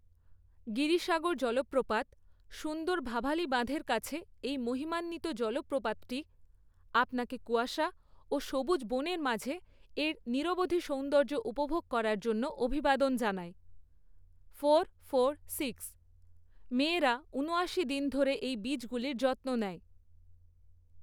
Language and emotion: Bengali, neutral